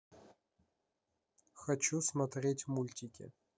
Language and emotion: Russian, neutral